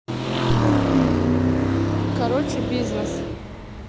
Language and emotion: Russian, neutral